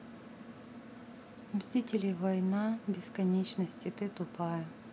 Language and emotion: Russian, neutral